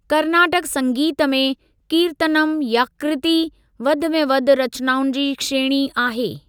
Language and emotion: Sindhi, neutral